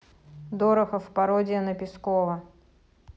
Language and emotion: Russian, neutral